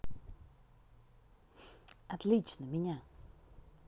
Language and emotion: Russian, positive